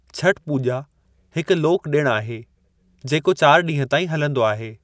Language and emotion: Sindhi, neutral